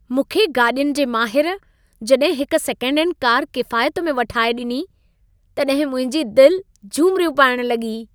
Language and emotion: Sindhi, happy